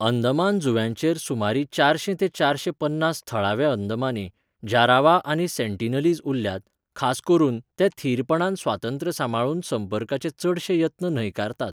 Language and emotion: Goan Konkani, neutral